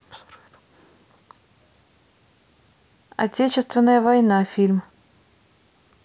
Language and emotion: Russian, neutral